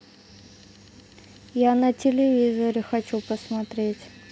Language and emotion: Russian, neutral